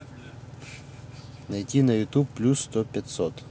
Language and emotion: Russian, neutral